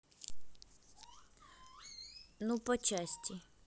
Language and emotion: Russian, neutral